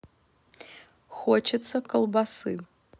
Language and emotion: Russian, neutral